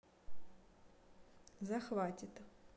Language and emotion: Russian, neutral